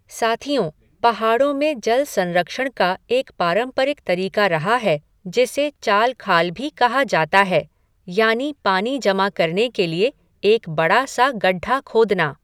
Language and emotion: Hindi, neutral